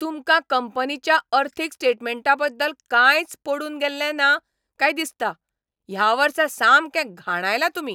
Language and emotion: Goan Konkani, angry